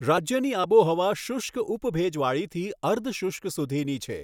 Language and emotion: Gujarati, neutral